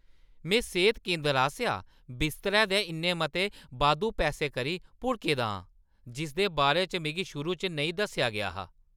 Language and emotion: Dogri, angry